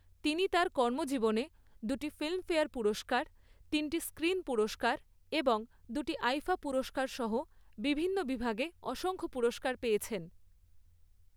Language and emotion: Bengali, neutral